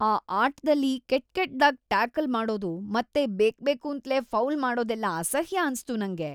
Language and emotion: Kannada, disgusted